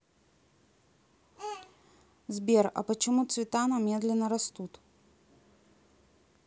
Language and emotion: Russian, neutral